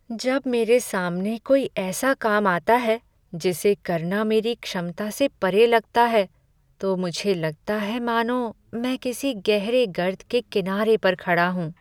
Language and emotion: Hindi, sad